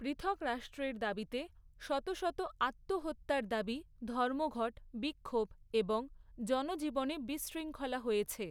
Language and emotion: Bengali, neutral